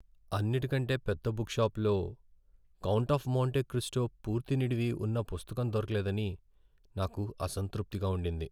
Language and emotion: Telugu, sad